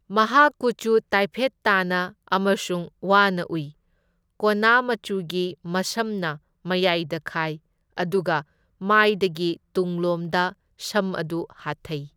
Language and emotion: Manipuri, neutral